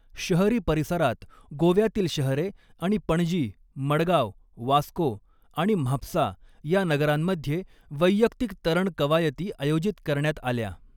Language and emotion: Marathi, neutral